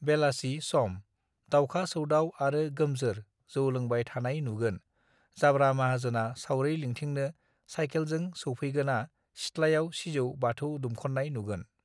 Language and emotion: Bodo, neutral